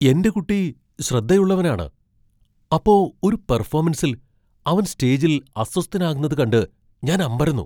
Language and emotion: Malayalam, surprised